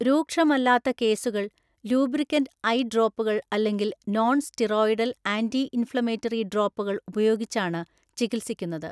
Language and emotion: Malayalam, neutral